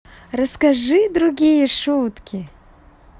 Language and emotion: Russian, positive